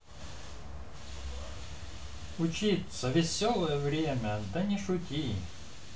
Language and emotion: Russian, positive